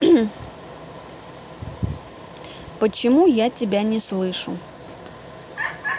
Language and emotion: Russian, neutral